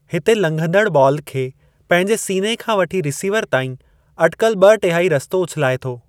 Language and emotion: Sindhi, neutral